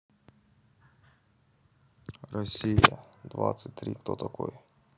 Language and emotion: Russian, neutral